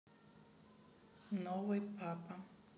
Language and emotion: Russian, neutral